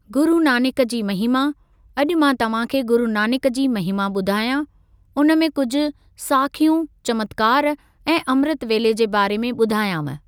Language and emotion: Sindhi, neutral